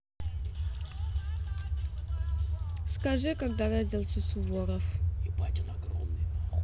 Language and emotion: Russian, neutral